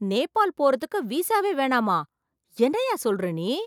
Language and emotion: Tamil, surprised